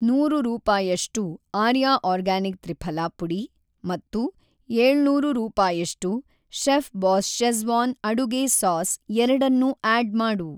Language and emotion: Kannada, neutral